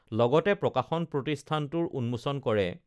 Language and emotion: Assamese, neutral